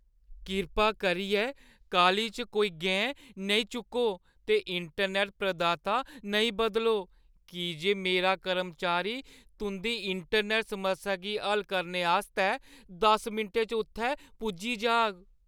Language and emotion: Dogri, fearful